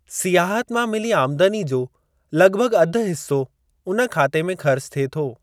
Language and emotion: Sindhi, neutral